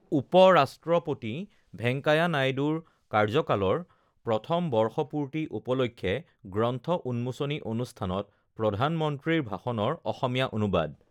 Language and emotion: Assamese, neutral